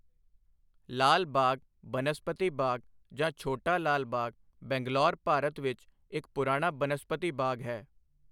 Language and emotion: Punjabi, neutral